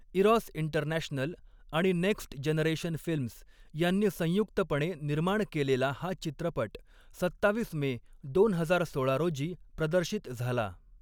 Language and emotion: Marathi, neutral